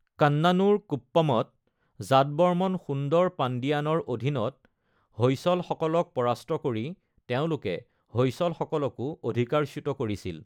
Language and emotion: Assamese, neutral